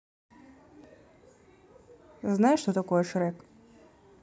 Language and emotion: Russian, neutral